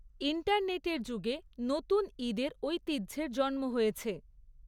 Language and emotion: Bengali, neutral